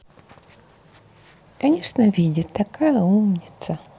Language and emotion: Russian, positive